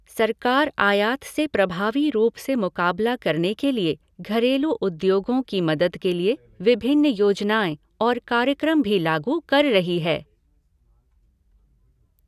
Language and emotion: Hindi, neutral